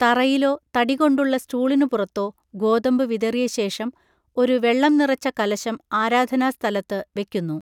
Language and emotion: Malayalam, neutral